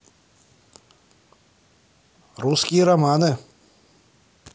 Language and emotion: Russian, neutral